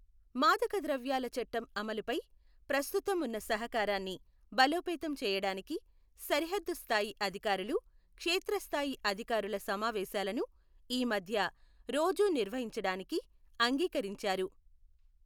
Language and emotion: Telugu, neutral